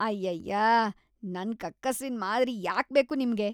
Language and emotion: Kannada, disgusted